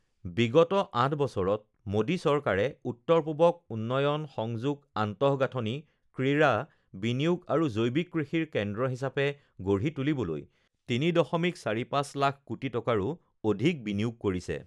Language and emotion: Assamese, neutral